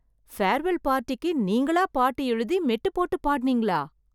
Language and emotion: Tamil, surprised